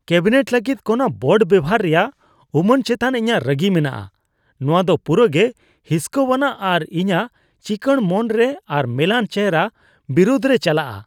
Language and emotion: Santali, disgusted